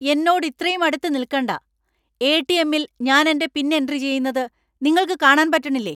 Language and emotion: Malayalam, angry